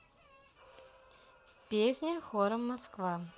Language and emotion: Russian, neutral